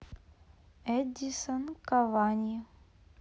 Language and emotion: Russian, neutral